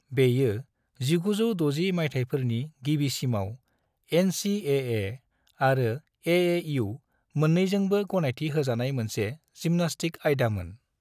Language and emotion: Bodo, neutral